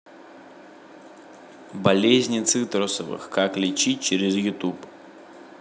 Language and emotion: Russian, neutral